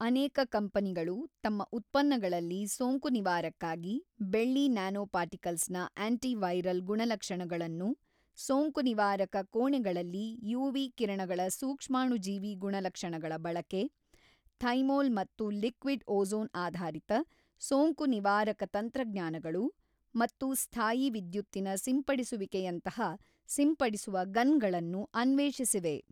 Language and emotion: Kannada, neutral